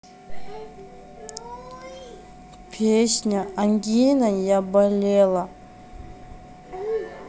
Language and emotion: Russian, sad